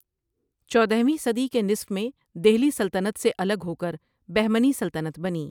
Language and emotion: Urdu, neutral